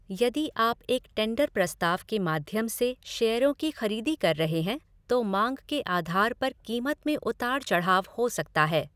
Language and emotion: Hindi, neutral